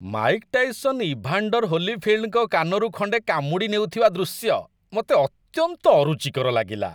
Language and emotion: Odia, disgusted